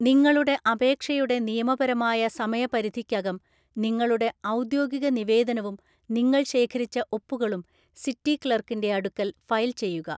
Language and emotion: Malayalam, neutral